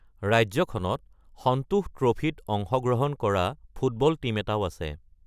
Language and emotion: Assamese, neutral